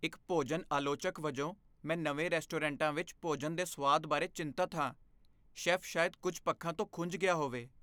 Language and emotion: Punjabi, fearful